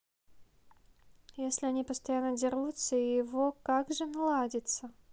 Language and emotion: Russian, neutral